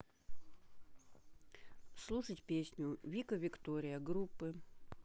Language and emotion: Russian, neutral